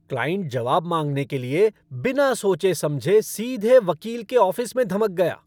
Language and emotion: Hindi, angry